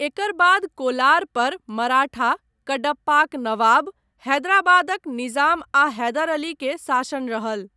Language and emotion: Maithili, neutral